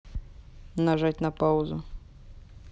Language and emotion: Russian, neutral